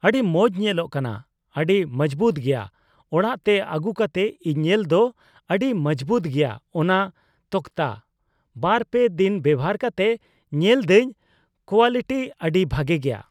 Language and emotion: Santali, neutral